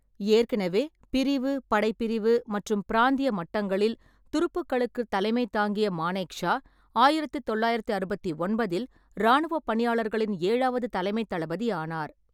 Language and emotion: Tamil, neutral